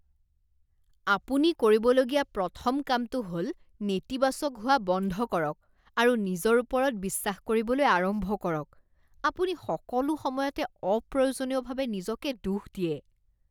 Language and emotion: Assamese, disgusted